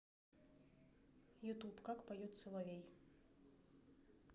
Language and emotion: Russian, neutral